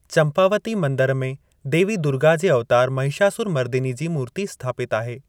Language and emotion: Sindhi, neutral